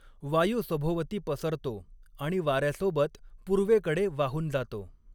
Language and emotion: Marathi, neutral